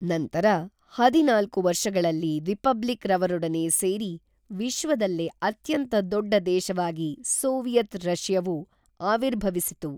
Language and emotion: Kannada, neutral